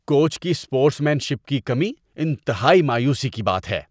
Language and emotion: Urdu, disgusted